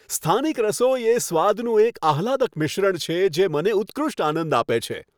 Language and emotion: Gujarati, happy